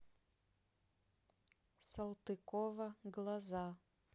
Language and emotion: Russian, neutral